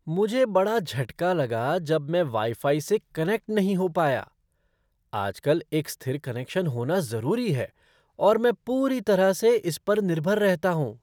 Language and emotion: Hindi, surprised